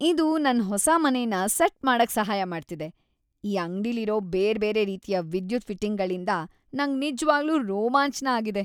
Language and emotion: Kannada, happy